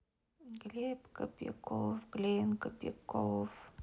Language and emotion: Russian, sad